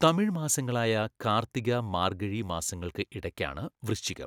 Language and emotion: Malayalam, neutral